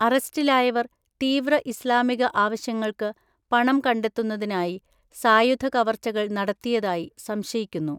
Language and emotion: Malayalam, neutral